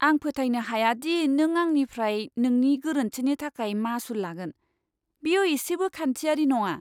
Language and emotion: Bodo, disgusted